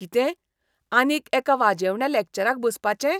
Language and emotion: Goan Konkani, disgusted